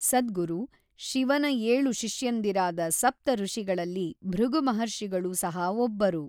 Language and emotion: Kannada, neutral